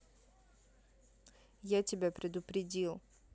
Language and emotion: Russian, neutral